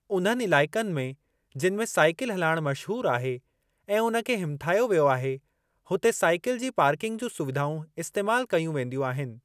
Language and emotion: Sindhi, neutral